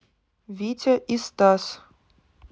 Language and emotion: Russian, neutral